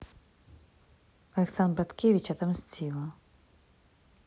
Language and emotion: Russian, neutral